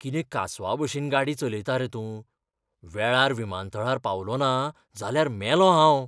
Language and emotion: Goan Konkani, fearful